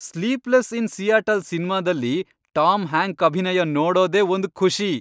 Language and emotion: Kannada, happy